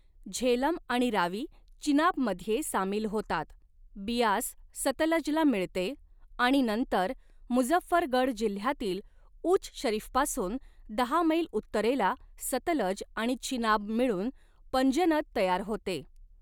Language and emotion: Marathi, neutral